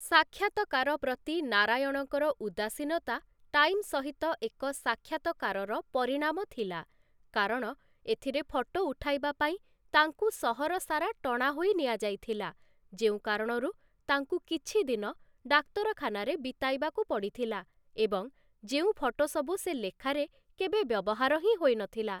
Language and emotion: Odia, neutral